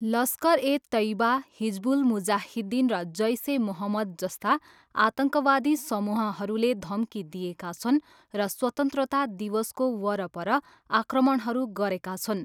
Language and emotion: Nepali, neutral